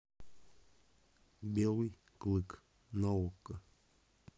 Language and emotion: Russian, neutral